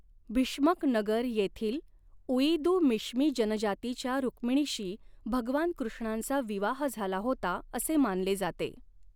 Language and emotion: Marathi, neutral